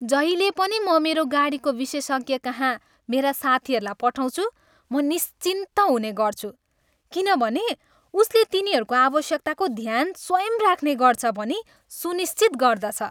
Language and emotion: Nepali, happy